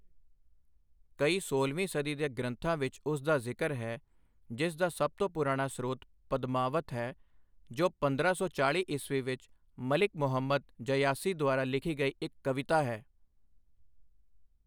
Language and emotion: Punjabi, neutral